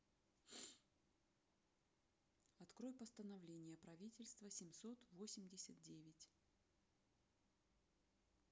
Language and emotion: Russian, neutral